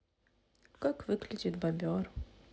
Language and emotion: Russian, sad